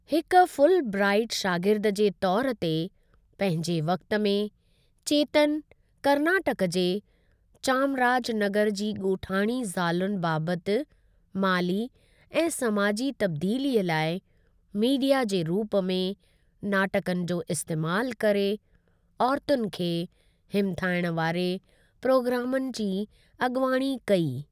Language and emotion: Sindhi, neutral